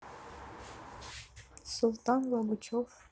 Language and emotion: Russian, neutral